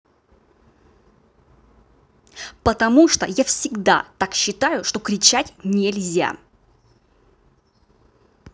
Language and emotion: Russian, angry